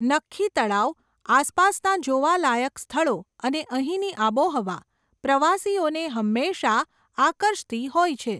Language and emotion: Gujarati, neutral